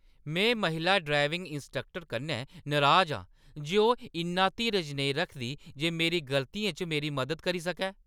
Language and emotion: Dogri, angry